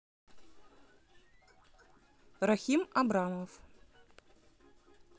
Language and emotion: Russian, neutral